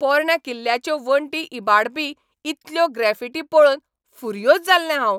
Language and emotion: Goan Konkani, angry